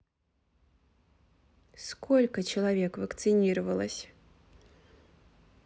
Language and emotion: Russian, neutral